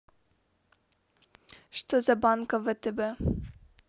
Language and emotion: Russian, neutral